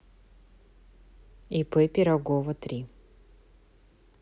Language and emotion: Russian, neutral